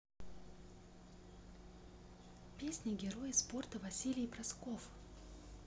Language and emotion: Russian, neutral